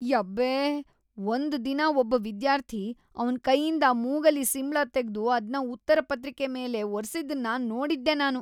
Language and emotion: Kannada, disgusted